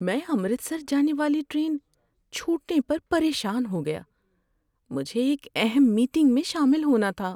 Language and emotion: Urdu, sad